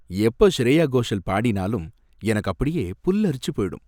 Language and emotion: Tamil, happy